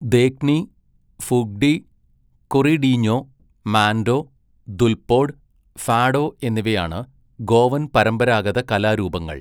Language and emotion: Malayalam, neutral